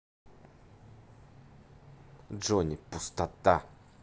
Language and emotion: Russian, angry